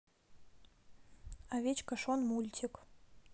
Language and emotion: Russian, neutral